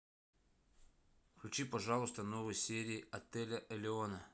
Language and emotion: Russian, neutral